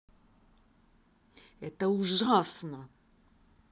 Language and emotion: Russian, angry